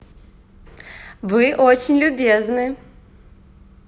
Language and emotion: Russian, positive